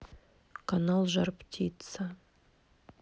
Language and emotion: Russian, neutral